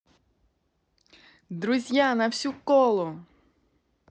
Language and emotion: Russian, positive